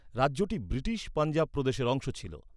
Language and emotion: Bengali, neutral